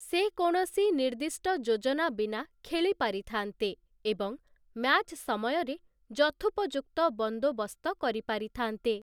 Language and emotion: Odia, neutral